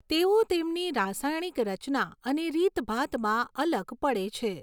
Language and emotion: Gujarati, neutral